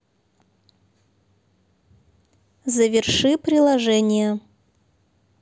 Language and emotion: Russian, neutral